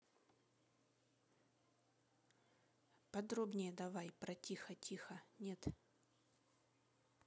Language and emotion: Russian, neutral